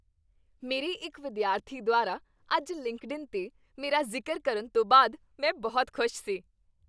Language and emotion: Punjabi, happy